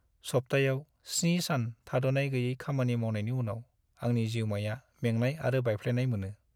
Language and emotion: Bodo, sad